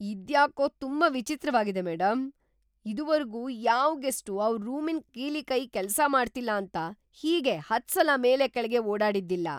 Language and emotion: Kannada, surprised